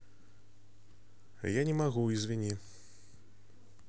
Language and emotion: Russian, neutral